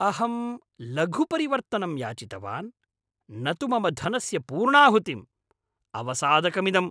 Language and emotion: Sanskrit, angry